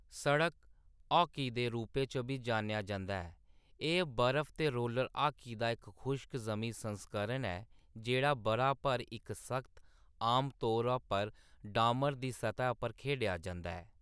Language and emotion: Dogri, neutral